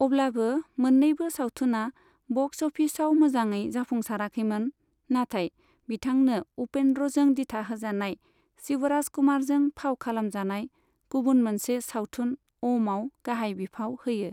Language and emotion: Bodo, neutral